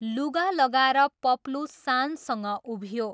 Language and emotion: Nepali, neutral